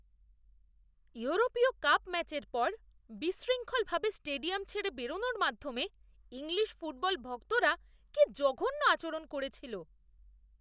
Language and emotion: Bengali, disgusted